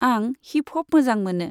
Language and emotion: Bodo, neutral